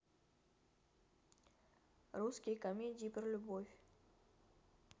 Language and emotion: Russian, neutral